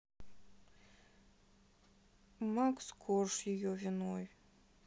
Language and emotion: Russian, sad